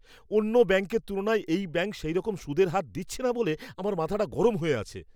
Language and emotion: Bengali, angry